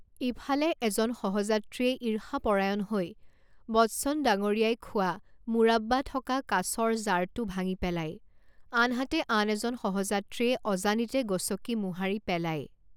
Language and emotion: Assamese, neutral